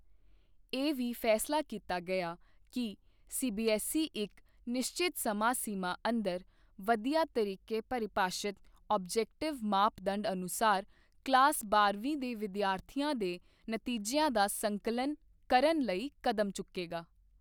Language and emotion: Punjabi, neutral